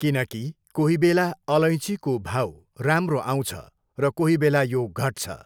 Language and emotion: Nepali, neutral